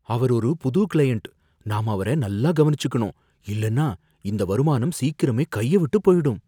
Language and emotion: Tamil, fearful